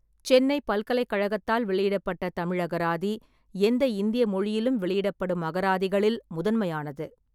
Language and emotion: Tamil, neutral